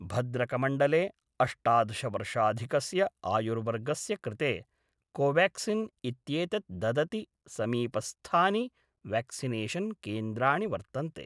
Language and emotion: Sanskrit, neutral